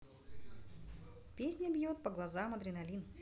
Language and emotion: Russian, positive